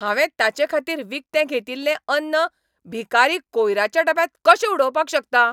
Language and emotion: Goan Konkani, angry